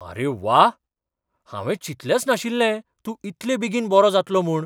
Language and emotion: Goan Konkani, surprised